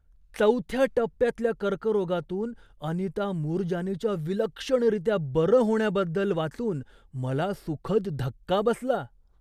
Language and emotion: Marathi, surprised